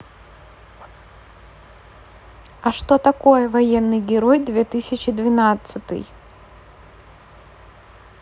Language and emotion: Russian, neutral